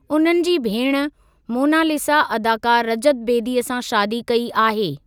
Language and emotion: Sindhi, neutral